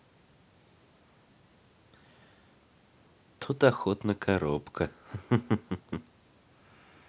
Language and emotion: Russian, positive